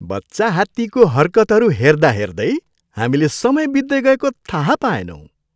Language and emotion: Nepali, happy